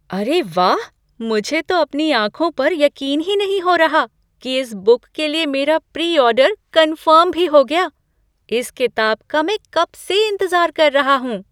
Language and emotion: Hindi, surprised